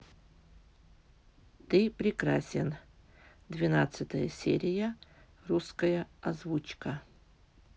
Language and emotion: Russian, neutral